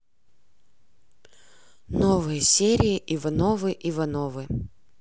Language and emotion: Russian, neutral